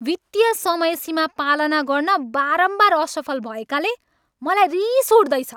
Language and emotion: Nepali, angry